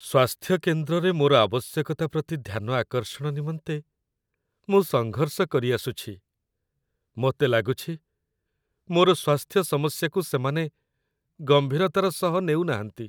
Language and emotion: Odia, sad